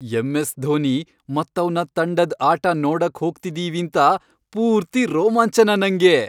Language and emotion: Kannada, happy